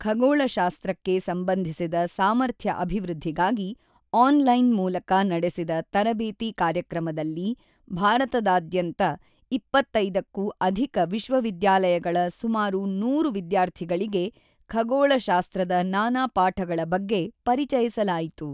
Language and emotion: Kannada, neutral